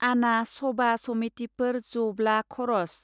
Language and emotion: Bodo, neutral